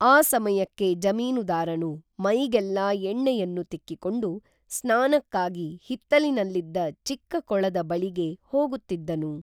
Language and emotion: Kannada, neutral